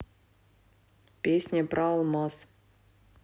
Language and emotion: Russian, neutral